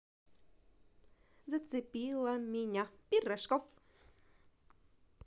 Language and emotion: Russian, positive